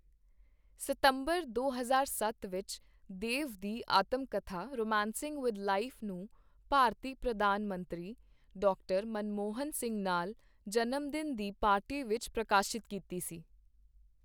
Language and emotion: Punjabi, neutral